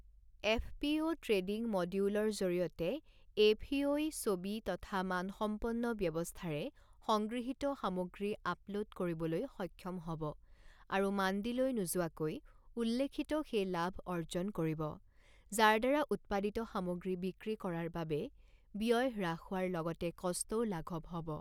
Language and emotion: Assamese, neutral